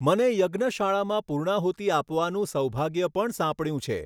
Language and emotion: Gujarati, neutral